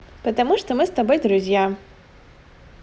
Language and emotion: Russian, positive